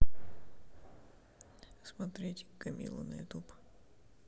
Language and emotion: Russian, neutral